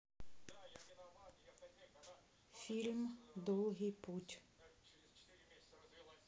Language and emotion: Russian, neutral